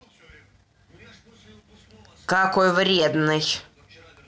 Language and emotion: Russian, angry